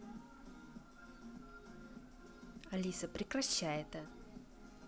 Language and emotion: Russian, neutral